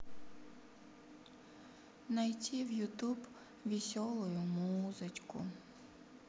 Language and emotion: Russian, sad